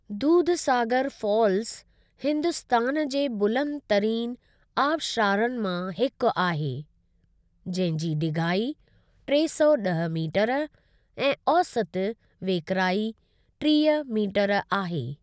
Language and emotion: Sindhi, neutral